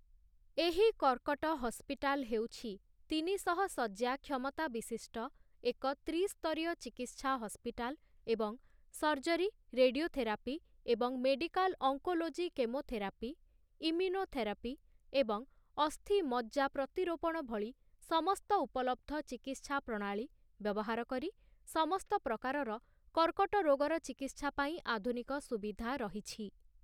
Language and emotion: Odia, neutral